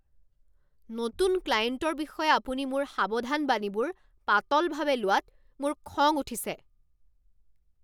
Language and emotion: Assamese, angry